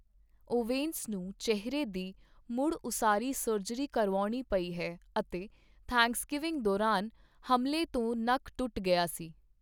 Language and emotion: Punjabi, neutral